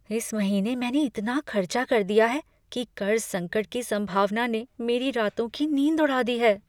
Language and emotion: Hindi, fearful